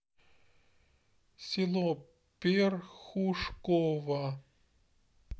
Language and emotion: Russian, neutral